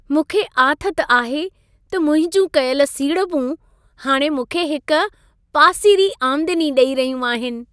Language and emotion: Sindhi, happy